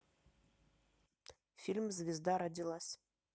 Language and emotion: Russian, neutral